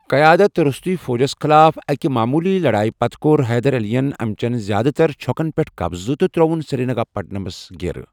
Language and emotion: Kashmiri, neutral